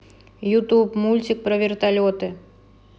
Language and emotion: Russian, neutral